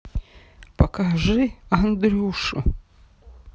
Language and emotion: Russian, sad